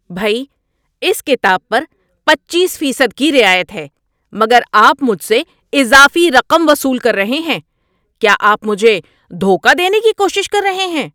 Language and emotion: Urdu, angry